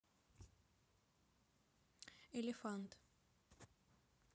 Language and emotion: Russian, neutral